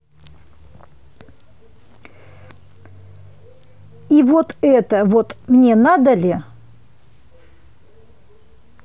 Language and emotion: Russian, angry